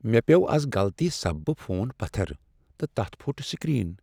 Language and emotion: Kashmiri, sad